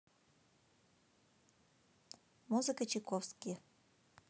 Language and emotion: Russian, neutral